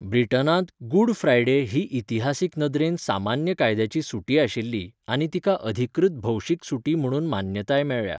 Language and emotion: Goan Konkani, neutral